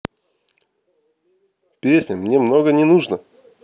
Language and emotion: Russian, neutral